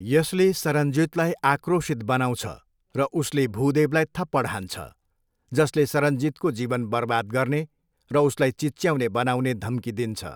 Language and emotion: Nepali, neutral